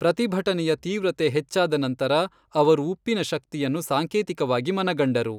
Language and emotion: Kannada, neutral